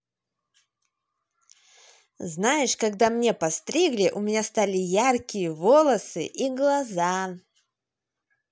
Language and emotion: Russian, positive